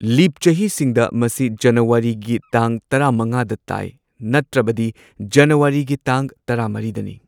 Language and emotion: Manipuri, neutral